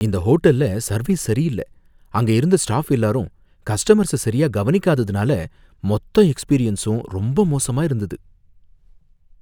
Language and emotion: Tamil, fearful